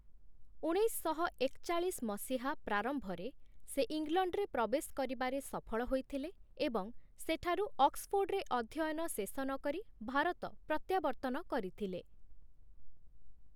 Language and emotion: Odia, neutral